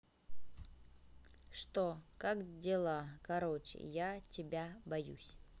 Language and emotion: Russian, neutral